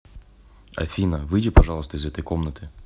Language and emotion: Russian, neutral